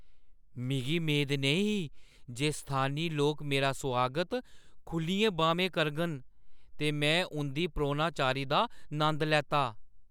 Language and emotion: Dogri, surprised